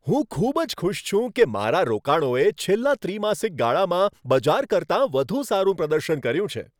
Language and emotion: Gujarati, happy